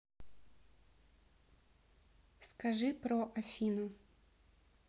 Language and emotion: Russian, neutral